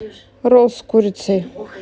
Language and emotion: Russian, neutral